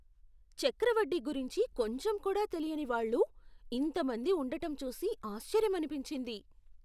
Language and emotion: Telugu, surprised